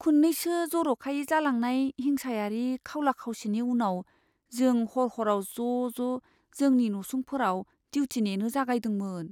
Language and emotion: Bodo, fearful